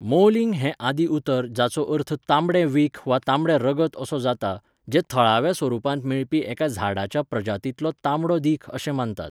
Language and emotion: Goan Konkani, neutral